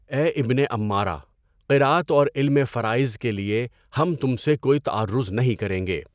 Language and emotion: Urdu, neutral